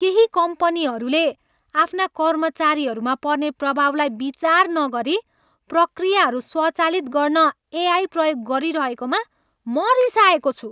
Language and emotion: Nepali, angry